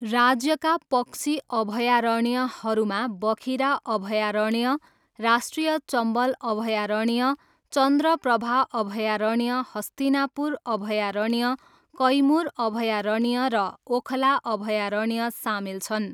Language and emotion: Nepali, neutral